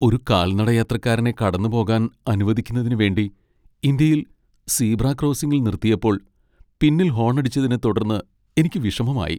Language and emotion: Malayalam, sad